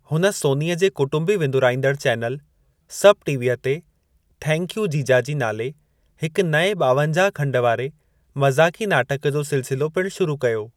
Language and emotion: Sindhi, neutral